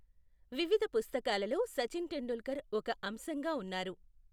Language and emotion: Telugu, neutral